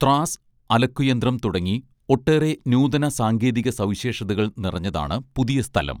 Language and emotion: Malayalam, neutral